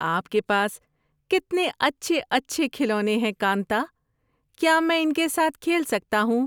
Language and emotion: Urdu, happy